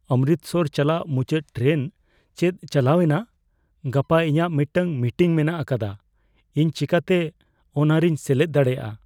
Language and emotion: Santali, fearful